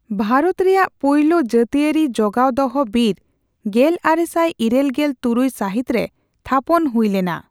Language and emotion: Santali, neutral